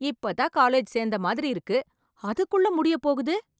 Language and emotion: Tamil, surprised